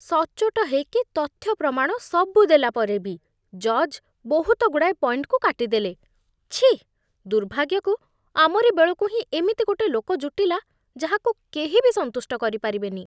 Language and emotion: Odia, disgusted